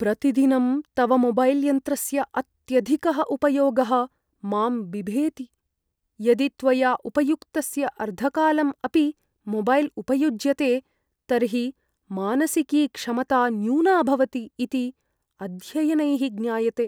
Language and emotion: Sanskrit, fearful